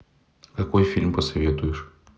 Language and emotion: Russian, neutral